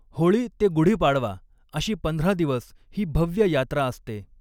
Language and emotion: Marathi, neutral